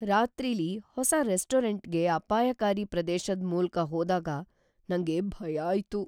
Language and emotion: Kannada, fearful